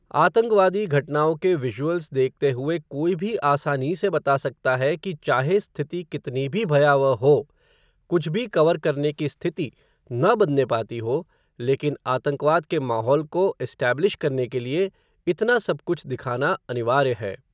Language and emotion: Hindi, neutral